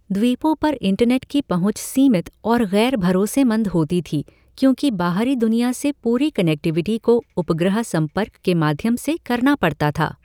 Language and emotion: Hindi, neutral